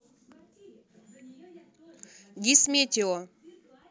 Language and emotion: Russian, neutral